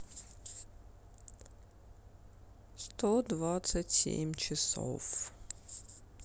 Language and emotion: Russian, sad